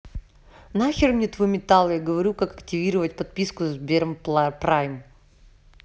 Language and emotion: Russian, neutral